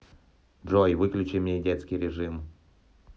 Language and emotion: Russian, neutral